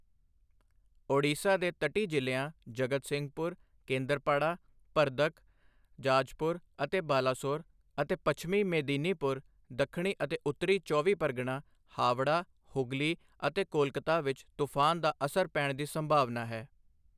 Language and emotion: Punjabi, neutral